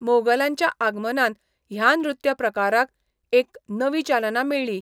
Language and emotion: Goan Konkani, neutral